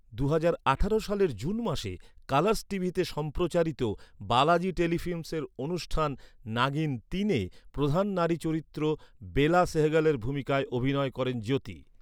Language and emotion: Bengali, neutral